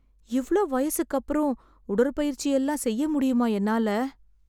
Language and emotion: Tamil, sad